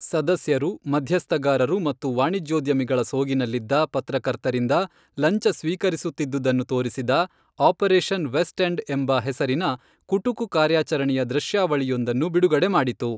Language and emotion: Kannada, neutral